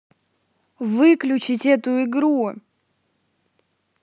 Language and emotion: Russian, angry